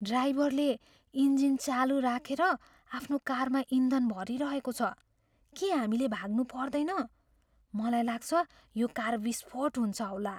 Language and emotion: Nepali, fearful